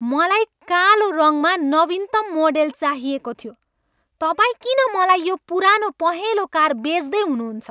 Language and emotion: Nepali, angry